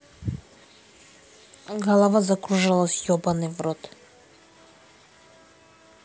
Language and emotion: Russian, neutral